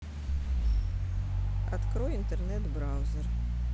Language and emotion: Russian, neutral